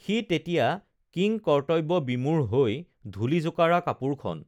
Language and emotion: Assamese, neutral